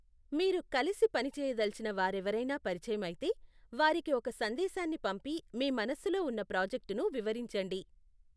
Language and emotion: Telugu, neutral